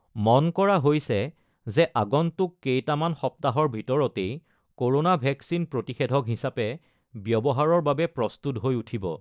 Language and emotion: Assamese, neutral